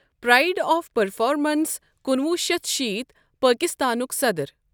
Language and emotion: Kashmiri, neutral